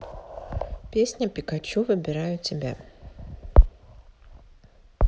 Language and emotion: Russian, neutral